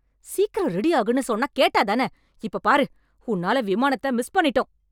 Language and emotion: Tamil, angry